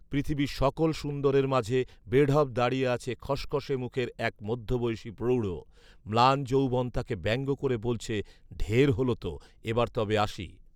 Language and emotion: Bengali, neutral